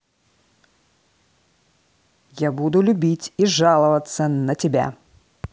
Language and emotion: Russian, angry